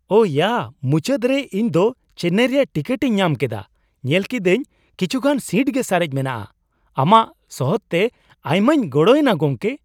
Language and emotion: Santali, surprised